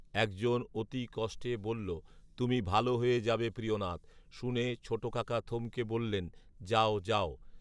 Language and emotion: Bengali, neutral